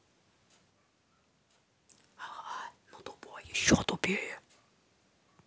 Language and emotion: Russian, angry